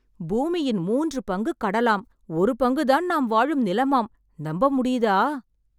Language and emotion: Tamil, surprised